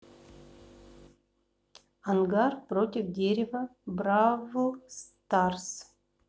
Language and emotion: Russian, neutral